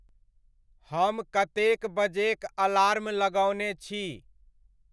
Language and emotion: Maithili, neutral